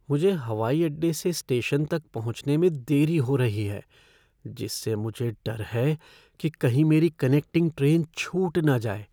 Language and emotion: Hindi, fearful